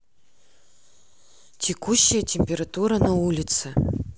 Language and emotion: Russian, neutral